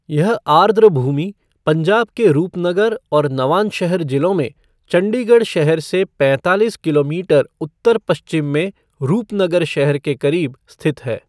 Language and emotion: Hindi, neutral